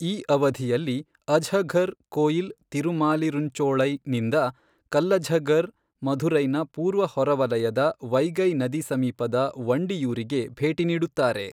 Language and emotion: Kannada, neutral